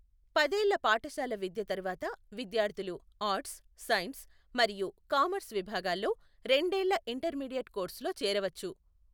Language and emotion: Telugu, neutral